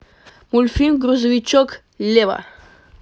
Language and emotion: Russian, positive